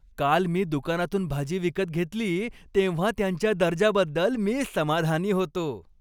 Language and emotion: Marathi, happy